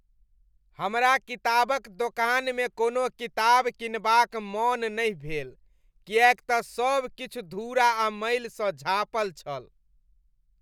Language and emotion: Maithili, disgusted